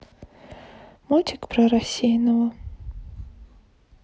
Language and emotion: Russian, sad